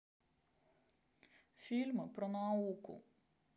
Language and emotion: Russian, neutral